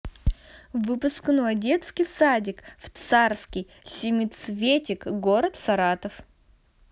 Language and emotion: Russian, positive